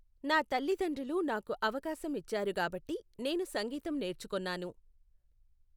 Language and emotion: Telugu, neutral